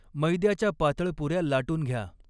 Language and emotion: Marathi, neutral